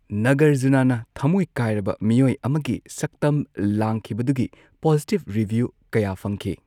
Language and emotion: Manipuri, neutral